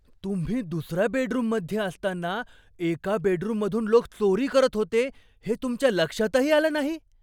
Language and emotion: Marathi, surprised